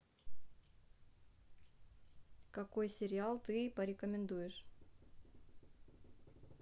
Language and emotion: Russian, neutral